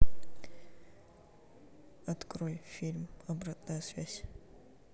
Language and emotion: Russian, neutral